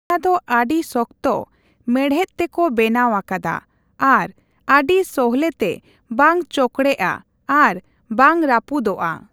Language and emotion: Santali, neutral